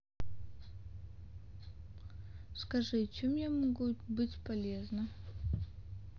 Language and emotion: Russian, sad